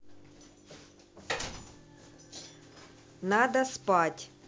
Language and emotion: Russian, angry